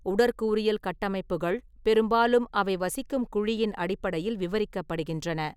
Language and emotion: Tamil, neutral